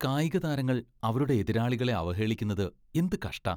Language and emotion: Malayalam, disgusted